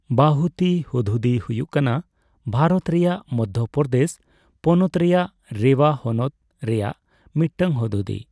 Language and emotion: Santali, neutral